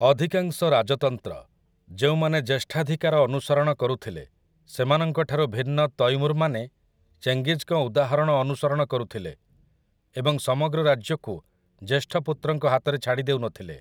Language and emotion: Odia, neutral